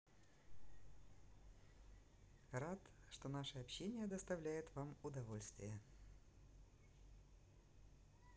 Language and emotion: Russian, positive